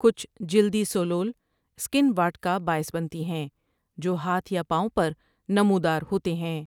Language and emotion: Urdu, neutral